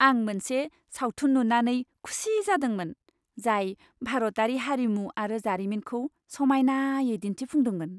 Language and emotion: Bodo, happy